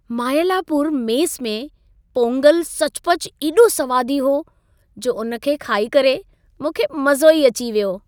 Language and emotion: Sindhi, happy